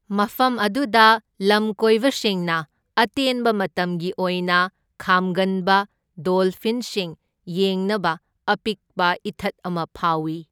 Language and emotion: Manipuri, neutral